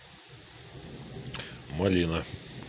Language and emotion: Russian, neutral